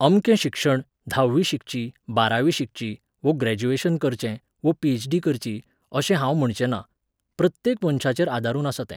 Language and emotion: Goan Konkani, neutral